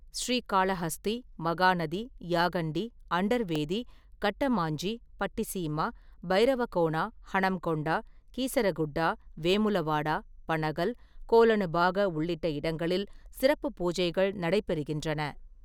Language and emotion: Tamil, neutral